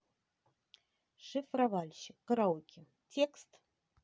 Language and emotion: Russian, neutral